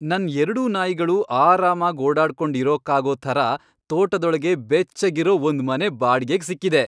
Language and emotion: Kannada, happy